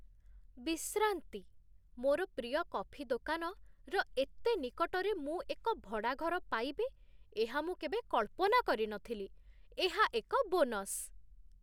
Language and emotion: Odia, surprised